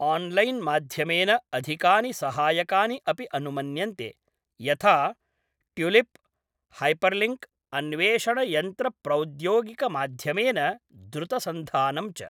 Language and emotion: Sanskrit, neutral